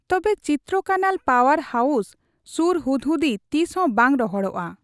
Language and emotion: Santali, neutral